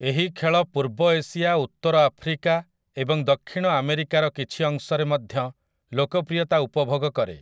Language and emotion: Odia, neutral